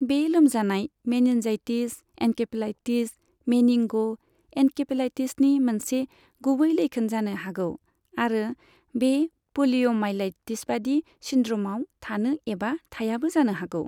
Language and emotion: Bodo, neutral